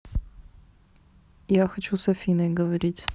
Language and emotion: Russian, neutral